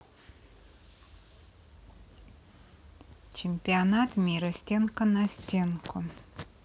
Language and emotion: Russian, neutral